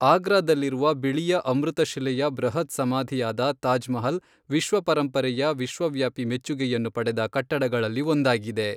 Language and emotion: Kannada, neutral